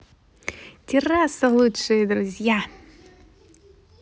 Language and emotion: Russian, positive